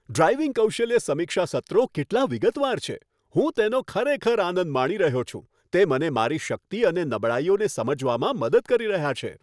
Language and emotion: Gujarati, happy